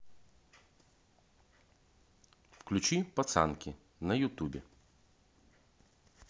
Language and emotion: Russian, neutral